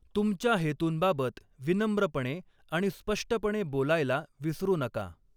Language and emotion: Marathi, neutral